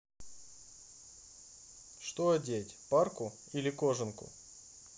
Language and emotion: Russian, neutral